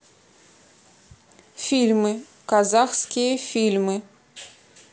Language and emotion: Russian, neutral